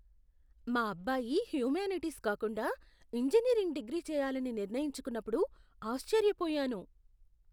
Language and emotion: Telugu, surprised